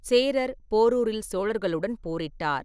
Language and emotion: Tamil, neutral